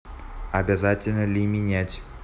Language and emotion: Russian, neutral